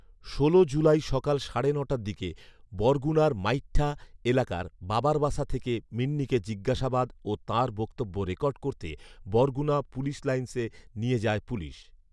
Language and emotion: Bengali, neutral